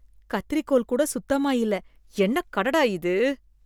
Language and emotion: Tamil, disgusted